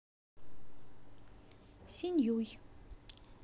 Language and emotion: Russian, positive